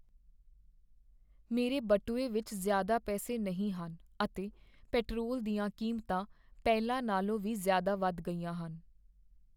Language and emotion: Punjabi, sad